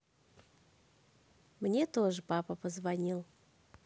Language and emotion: Russian, positive